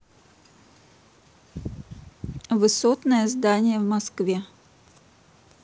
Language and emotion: Russian, neutral